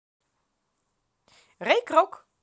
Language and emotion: Russian, positive